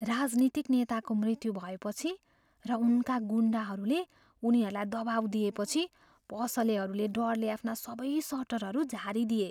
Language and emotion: Nepali, fearful